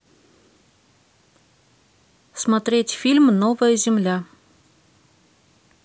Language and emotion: Russian, neutral